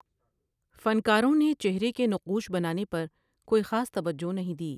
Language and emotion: Urdu, neutral